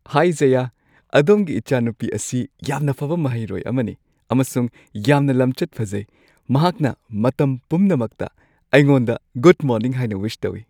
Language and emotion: Manipuri, happy